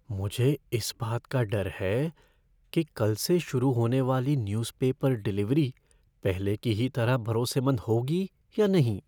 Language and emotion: Hindi, fearful